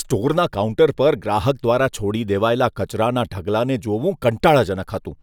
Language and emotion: Gujarati, disgusted